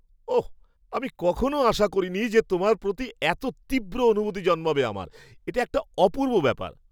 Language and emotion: Bengali, surprised